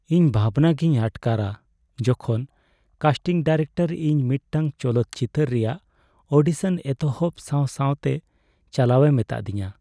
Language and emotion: Santali, sad